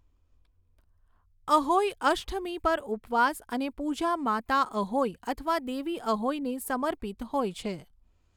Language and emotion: Gujarati, neutral